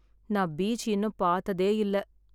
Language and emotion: Tamil, sad